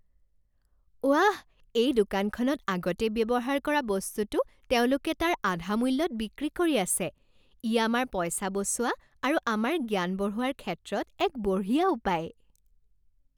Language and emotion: Assamese, happy